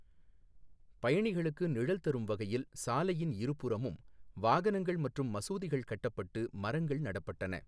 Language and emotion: Tamil, neutral